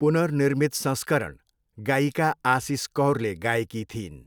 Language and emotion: Nepali, neutral